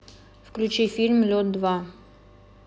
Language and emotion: Russian, neutral